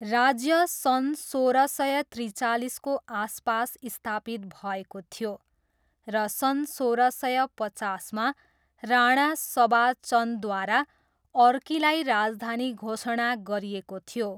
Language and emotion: Nepali, neutral